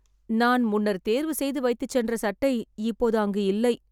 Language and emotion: Tamil, sad